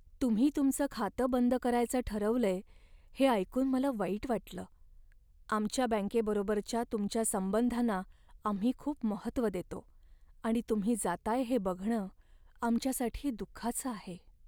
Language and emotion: Marathi, sad